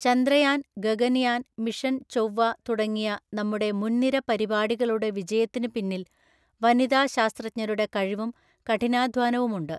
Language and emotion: Malayalam, neutral